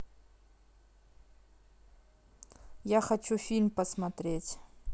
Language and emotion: Russian, neutral